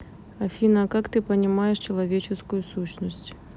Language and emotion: Russian, neutral